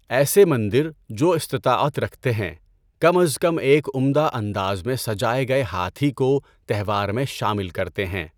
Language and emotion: Urdu, neutral